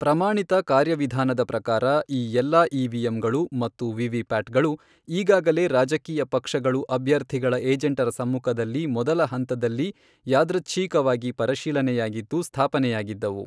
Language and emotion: Kannada, neutral